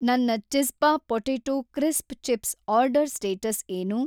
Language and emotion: Kannada, neutral